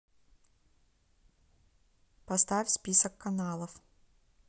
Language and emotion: Russian, neutral